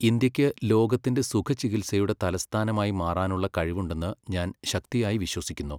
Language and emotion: Malayalam, neutral